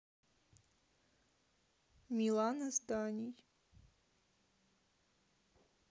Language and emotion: Russian, neutral